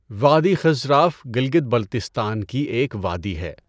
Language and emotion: Urdu, neutral